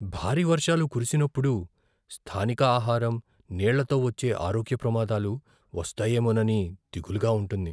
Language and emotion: Telugu, fearful